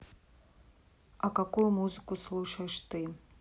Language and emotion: Russian, neutral